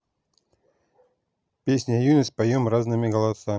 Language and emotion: Russian, neutral